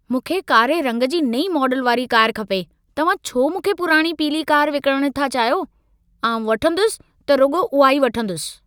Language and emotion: Sindhi, angry